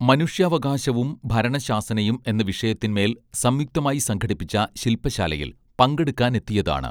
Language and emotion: Malayalam, neutral